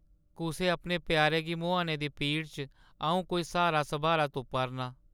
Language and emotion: Dogri, sad